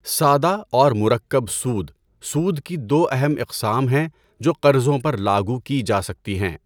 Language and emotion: Urdu, neutral